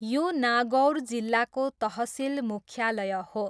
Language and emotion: Nepali, neutral